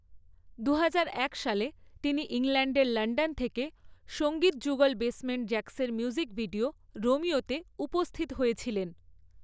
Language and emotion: Bengali, neutral